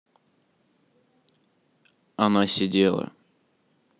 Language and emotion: Russian, neutral